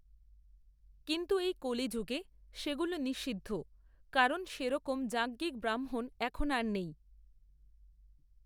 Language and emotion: Bengali, neutral